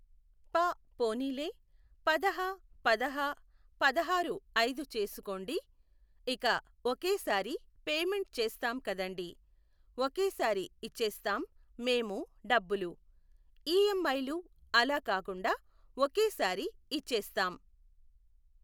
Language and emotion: Telugu, neutral